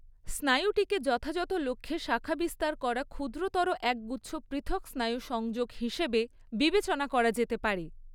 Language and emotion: Bengali, neutral